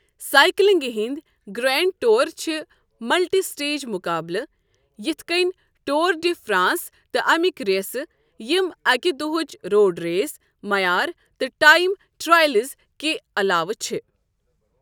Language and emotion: Kashmiri, neutral